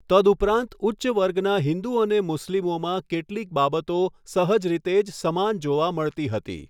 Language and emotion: Gujarati, neutral